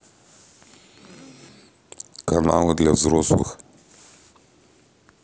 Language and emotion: Russian, neutral